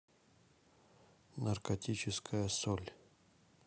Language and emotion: Russian, neutral